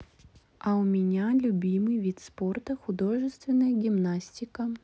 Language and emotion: Russian, neutral